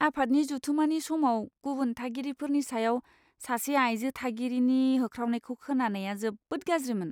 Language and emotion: Bodo, disgusted